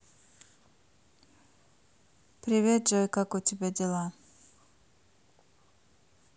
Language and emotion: Russian, neutral